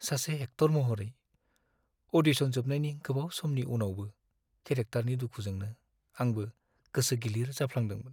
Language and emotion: Bodo, sad